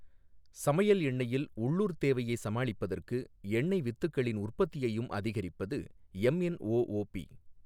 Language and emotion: Tamil, neutral